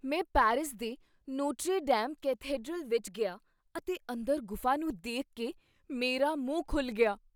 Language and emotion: Punjabi, surprised